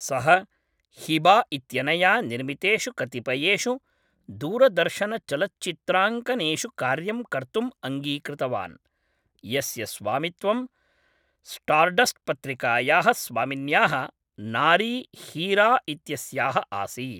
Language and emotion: Sanskrit, neutral